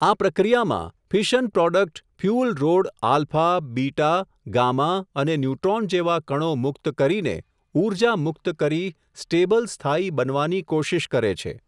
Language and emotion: Gujarati, neutral